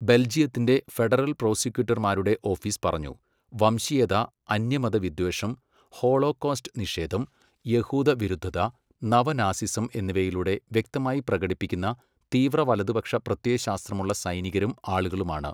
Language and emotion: Malayalam, neutral